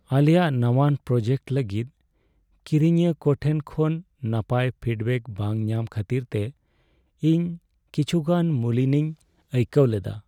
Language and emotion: Santali, sad